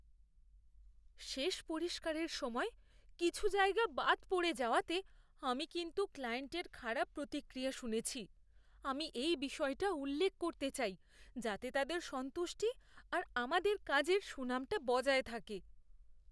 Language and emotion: Bengali, fearful